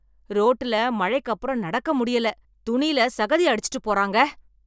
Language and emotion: Tamil, angry